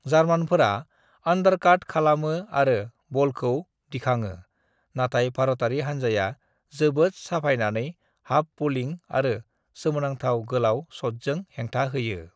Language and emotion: Bodo, neutral